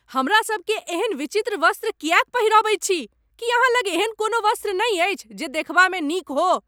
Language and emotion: Maithili, angry